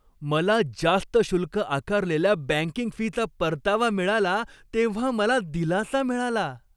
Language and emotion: Marathi, happy